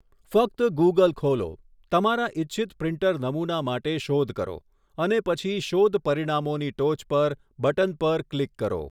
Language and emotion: Gujarati, neutral